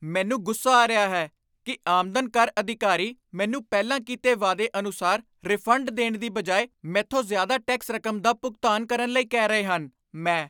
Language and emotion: Punjabi, angry